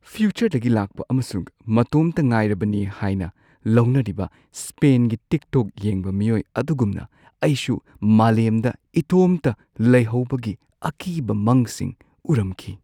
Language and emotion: Manipuri, fearful